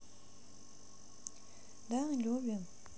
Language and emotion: Russian, neutral